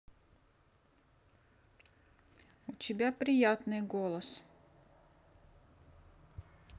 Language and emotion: Russian, neutral